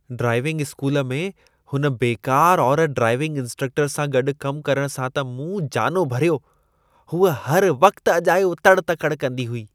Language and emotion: Sindhi, disgusted